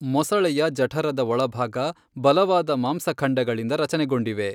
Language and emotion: Kannada, neutral